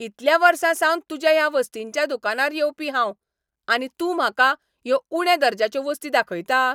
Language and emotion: Goan Konkani, angry